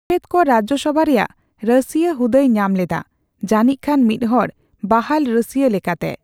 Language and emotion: Santali, neutral